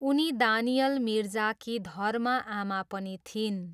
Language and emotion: Nepali, neutral